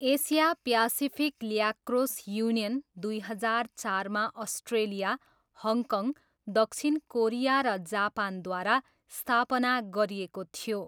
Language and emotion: Nepali, neutral